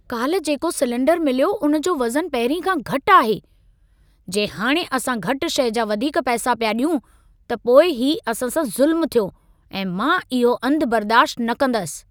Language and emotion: Sindhi, angry